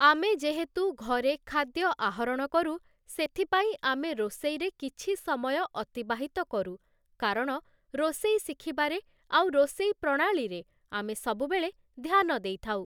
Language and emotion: Odia, neutral